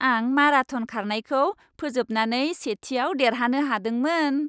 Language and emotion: Bodo, happy